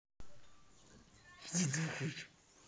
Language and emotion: Russian, angry